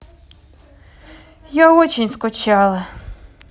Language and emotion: Russian, sad